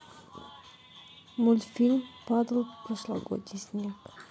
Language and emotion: Russian, neutral